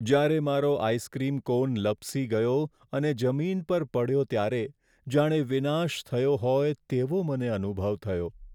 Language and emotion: Gujarati, sad